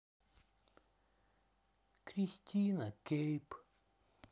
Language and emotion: Russian, sad